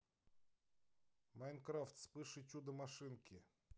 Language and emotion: Russian, neutral